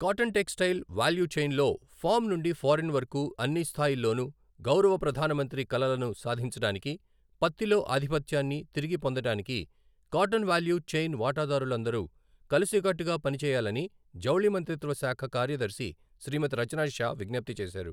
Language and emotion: Telugu, neutral